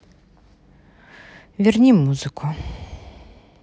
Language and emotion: Russian, neutral